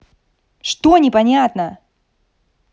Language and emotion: Russian, angry